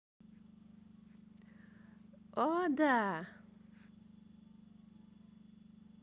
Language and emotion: Russian, positive